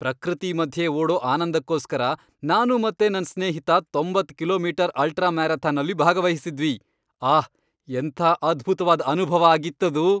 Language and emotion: Kannada, happy